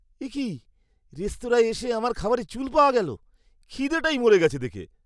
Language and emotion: Bengali, disgusted